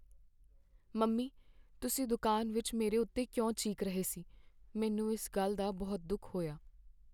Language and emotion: Punjabi, sad